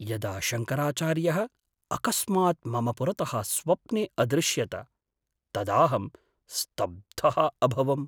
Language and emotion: Sanskrit, surprised